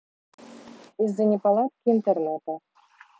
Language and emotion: Russian, neutral